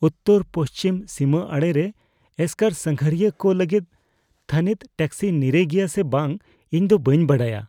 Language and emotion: Santali, fearful